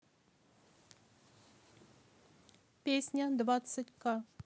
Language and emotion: Russian, neutral